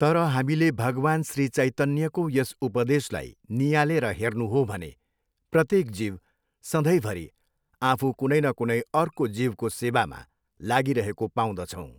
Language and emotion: Nepali, neutral